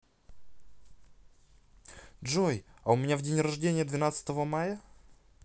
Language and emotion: Russian, neutral